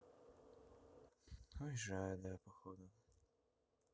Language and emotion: Russian, sad